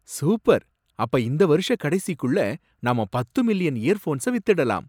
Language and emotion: Tamil, surprised